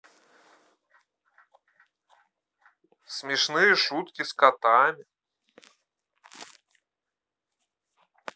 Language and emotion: Russian, neutral